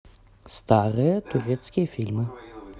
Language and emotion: Russian, neutral